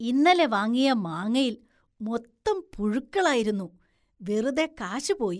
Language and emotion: Malayalam, disgusted